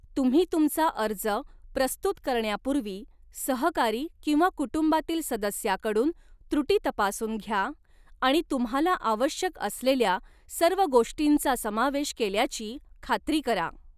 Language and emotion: Marathi, neutral